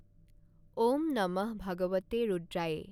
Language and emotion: Assamese, neutral